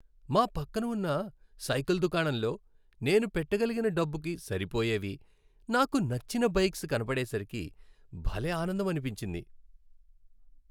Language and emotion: Telugu, happy